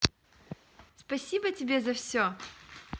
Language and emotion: Russian, positive